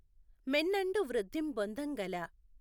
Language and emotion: Telugu, neutral